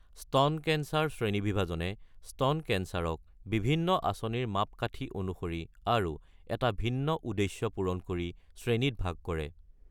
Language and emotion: Assamese, neutral